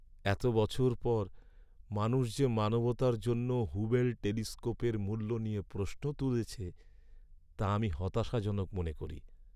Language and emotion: Bengali, sad